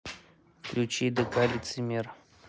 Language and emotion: Russian, neutral